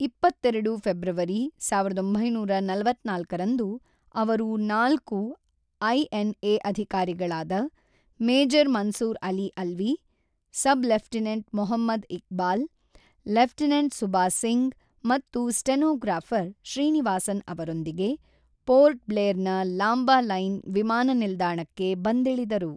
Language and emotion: Kannada, neutral